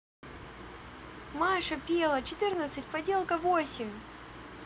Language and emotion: Russian, positive